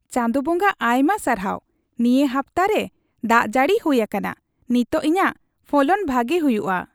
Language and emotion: Santali, happy